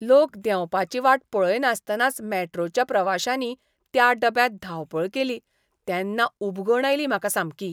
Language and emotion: Goan Konkani, disgusted